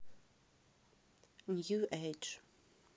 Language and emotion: Russian, neutral